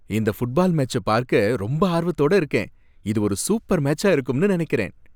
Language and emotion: Tamil, happy